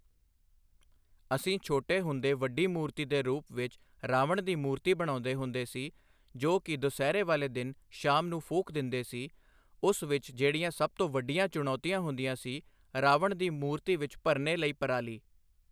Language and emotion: Punjabi, neutral